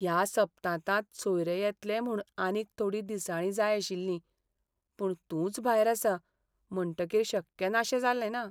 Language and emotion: Goan Konkani, sad